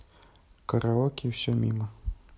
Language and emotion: Russian, neutral